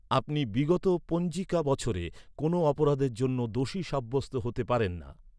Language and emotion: Bengali, neutral